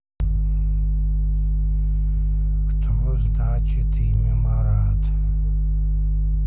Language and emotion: Russian, neutral